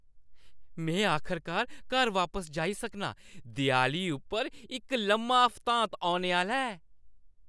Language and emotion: Dogri, happy